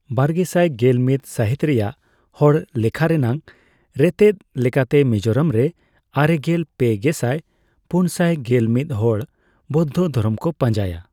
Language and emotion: Santali, neutral